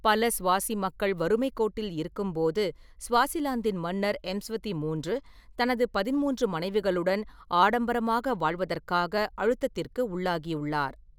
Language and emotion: Tamil, neutral